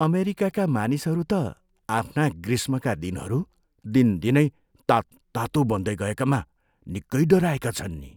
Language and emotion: Nepali, fearful